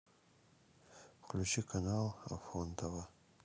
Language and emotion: Russian, neutral